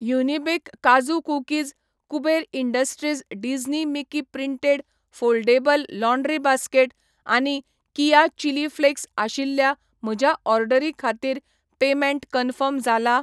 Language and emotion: Goan Konkani, neutral